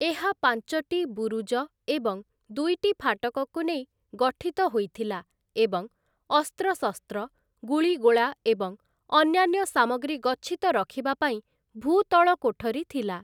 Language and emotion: Odia, neutral